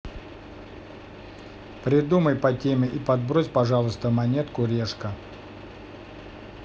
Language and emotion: Russian, neutral